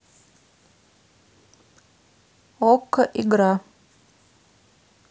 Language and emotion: Russian, neutral